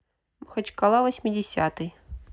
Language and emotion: Russian, neutral